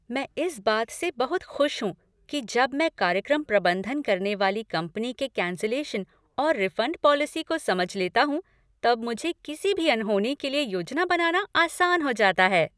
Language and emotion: Hindi, happy